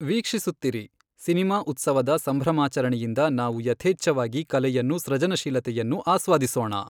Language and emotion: Kannada, neutral